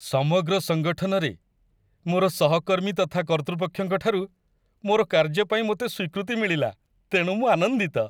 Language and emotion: Odia, happy